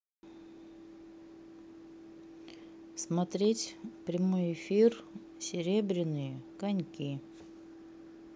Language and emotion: Russian, neutral